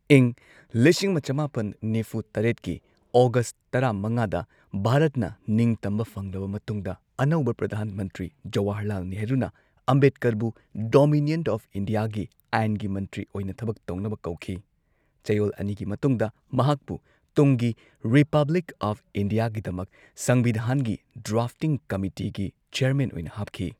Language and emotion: Manipuri, neutral